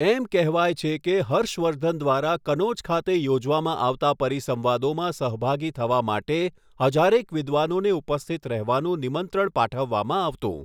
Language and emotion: Gujarati, neutral